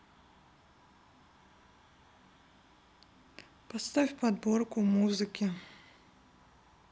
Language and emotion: Russian, neutral